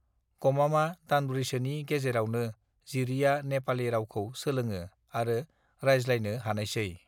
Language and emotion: Bodo, neutral